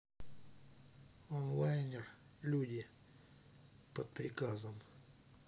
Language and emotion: Russian, neutral